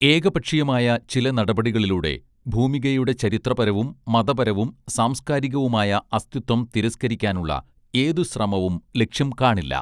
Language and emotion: Malayalam, neutral